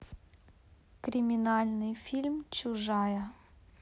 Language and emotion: Russian, neutral